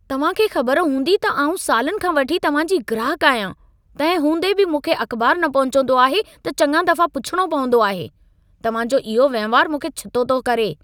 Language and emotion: Sindhi, angry